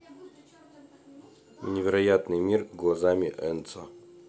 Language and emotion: Russian, neutral